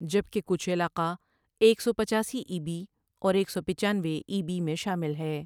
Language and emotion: Urdu, neutral